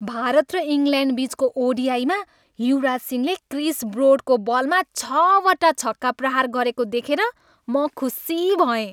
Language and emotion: Nepali, happy